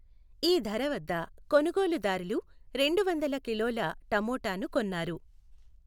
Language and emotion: Telugu, neutral